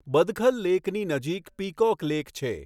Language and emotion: Gujarati, neutral